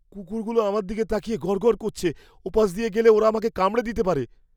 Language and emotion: Bengali, fearful